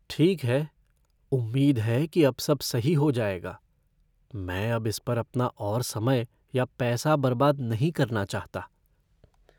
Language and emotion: Hindi, fearful